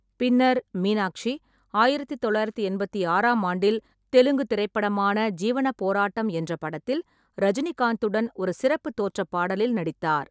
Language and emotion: Tamil, neutral